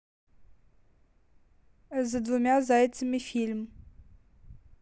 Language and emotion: Russian, neutral